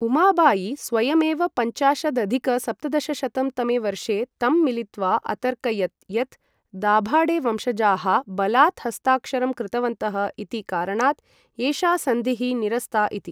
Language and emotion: Sanskrit, neutral